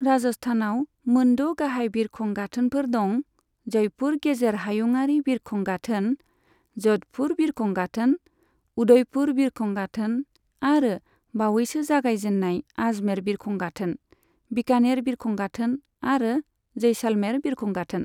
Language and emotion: Bodo, neutral